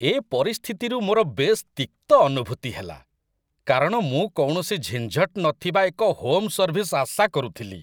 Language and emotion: Odia, disgusted